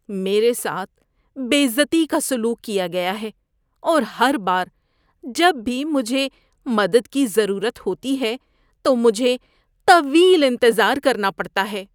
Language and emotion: Urdu, disgusted